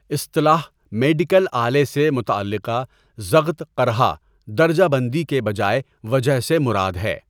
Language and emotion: Urdu, neutral